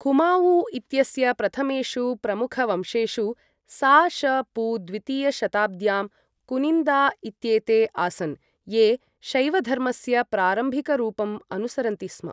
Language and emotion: Sanskrit, neutral